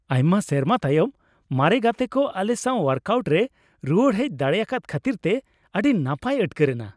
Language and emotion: Santali, happy